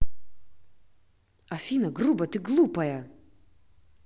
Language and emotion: Russian, angry